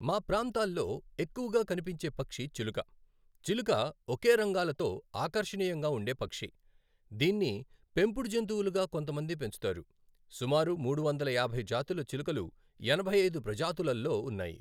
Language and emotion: Telugu, neutral